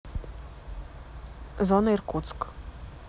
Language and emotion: Russian, neutral